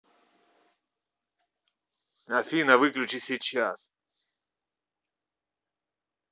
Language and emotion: Russian, angry